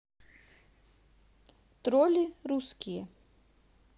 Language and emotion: Russian, neutral